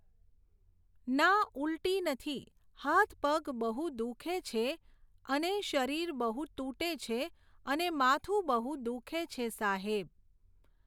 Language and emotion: Gujarati, neutral